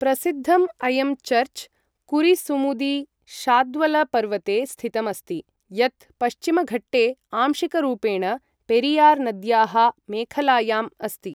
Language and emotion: Sanskrit, neutral